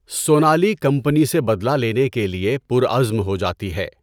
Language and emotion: Urdu, neutral